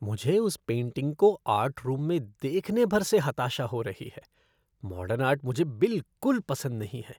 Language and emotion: Hindi, disgusted